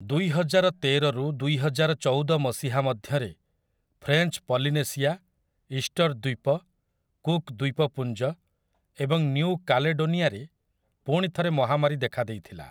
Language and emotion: Odia, neutral